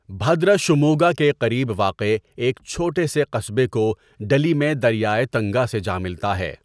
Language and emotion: Urdu, neutral